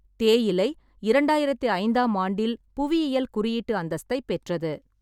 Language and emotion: Tamil, neutral